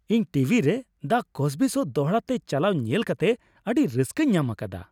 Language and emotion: Santali, happy